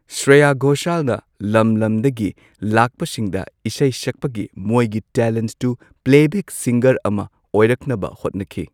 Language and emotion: Manipuri, neutral